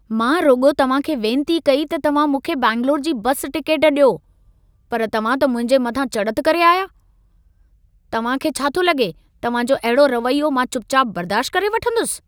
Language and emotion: Sindhi, angry